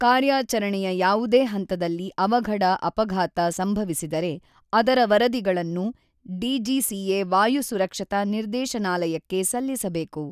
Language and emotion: Kannada, neutral